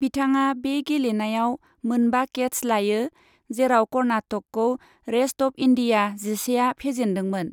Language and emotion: Bodo, neutral